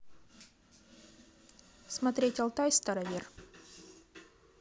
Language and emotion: Russian, neutral